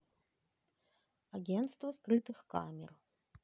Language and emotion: Russian, neutral